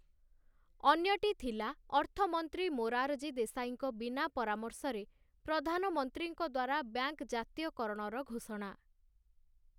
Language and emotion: Odia, neutral